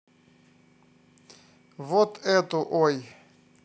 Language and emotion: Russian, neutral